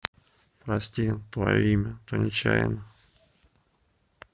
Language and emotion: Russian, sad